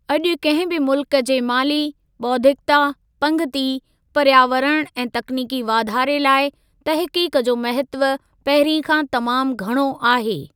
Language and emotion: Sindhi, neutral